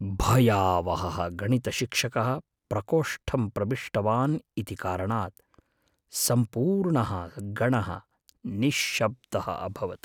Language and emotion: Sanskrit, fearful